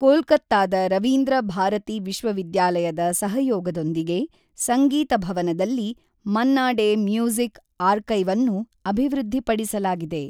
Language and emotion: Kannada, neutral